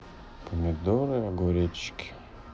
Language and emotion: Russian, sad